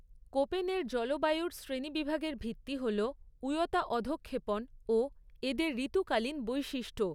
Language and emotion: Bengali, neutral